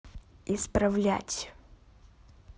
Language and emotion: Russian, neutral